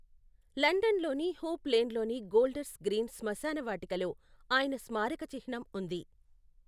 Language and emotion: Telugu, neutral